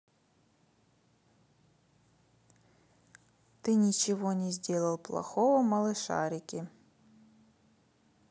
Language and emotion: Russian, neutral